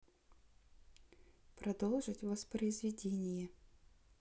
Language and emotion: Russian, neutral